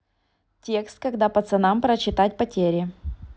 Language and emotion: Russian, neutral